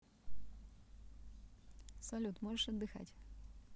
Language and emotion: Russian, neutral